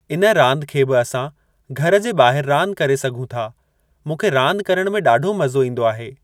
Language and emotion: Sindhi, neutral